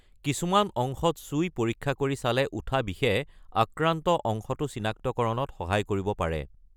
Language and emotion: Assamese, neutral